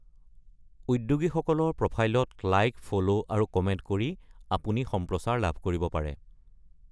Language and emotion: Assamese, neutral